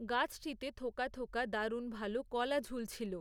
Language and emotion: Bengali, neutral